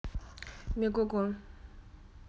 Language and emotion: Russian, neutral